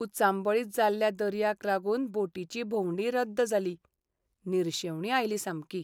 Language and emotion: Goan Konkani, sad